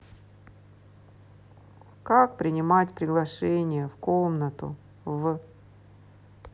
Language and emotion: Russian, sad